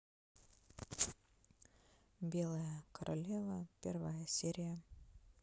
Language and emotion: Russian, sad